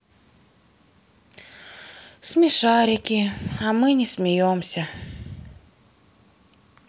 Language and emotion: Russian, sad